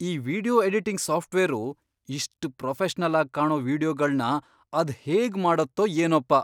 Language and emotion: Kannada, surprised